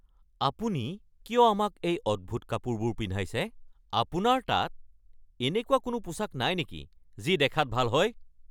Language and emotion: Assamese, angry